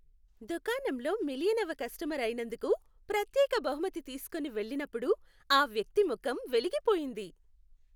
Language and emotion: Telugu, happy